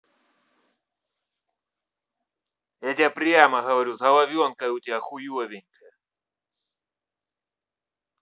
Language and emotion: Russian, angry